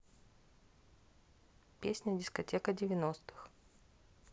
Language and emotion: Russian, neutral